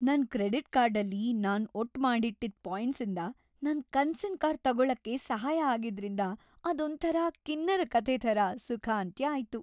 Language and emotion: Kannada, happy